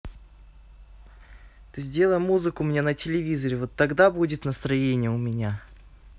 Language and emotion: Russian, angry